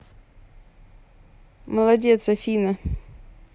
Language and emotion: Russian, positive